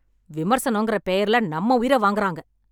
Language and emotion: Tamil, angry